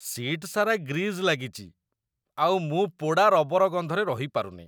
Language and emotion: Odia, disgusted